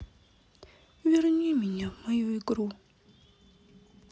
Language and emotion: Russian, sad